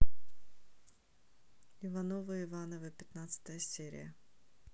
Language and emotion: Russian, neutral